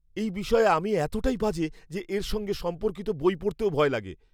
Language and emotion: Bengali, fearful